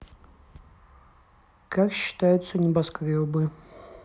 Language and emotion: Russian, neutral